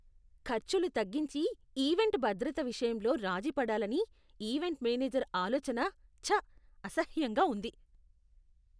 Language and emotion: Telugu, disgusted